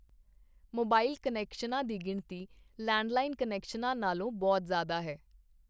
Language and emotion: Punjabi, neutral